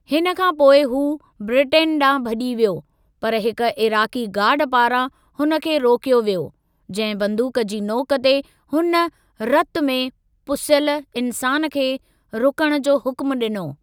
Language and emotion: Sindhi, neutral